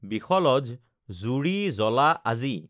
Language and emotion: Assamese, neutral